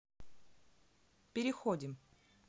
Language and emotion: Russian, neutral